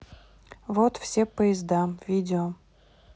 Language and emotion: Russian, neutral